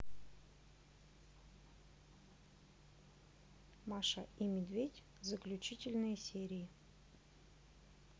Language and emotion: Russian, neutral